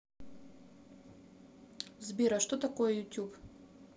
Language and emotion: Russian, neutral